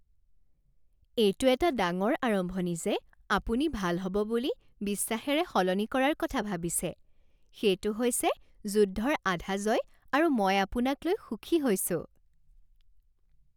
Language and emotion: Assamese, happy